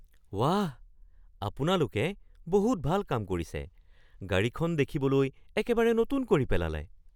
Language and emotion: Assamese, surprised